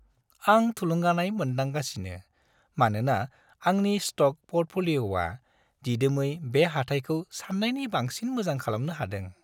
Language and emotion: Bodo, happy